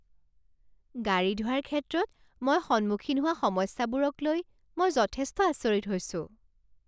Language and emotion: Assamese, surprised